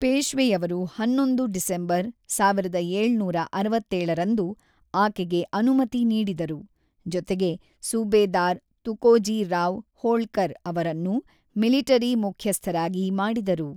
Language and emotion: Kannada, neutral